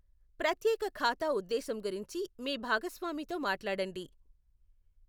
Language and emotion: Telugu, neutral